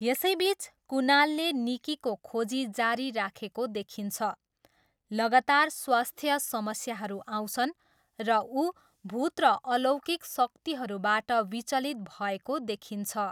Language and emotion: Nepali, neutral